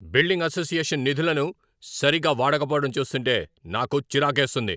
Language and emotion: Telugu, angry